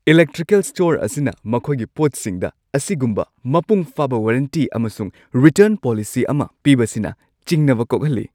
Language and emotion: Manipuri, happy